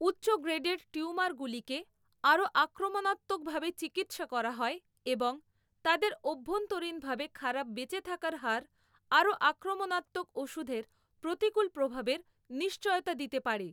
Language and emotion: Bengali, neutral